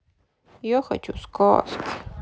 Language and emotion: Russian, sad